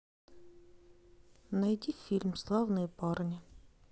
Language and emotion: Russian, neutral